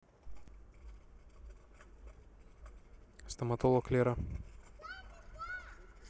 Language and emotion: Russian, neutral